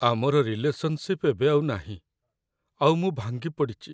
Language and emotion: Odia, sad